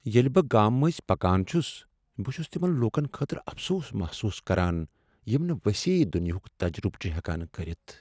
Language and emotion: Kashmiri, sad